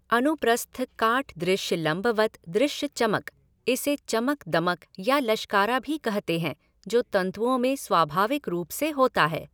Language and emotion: Hindi, neutral